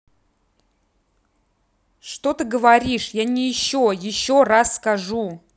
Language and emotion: Russian, angry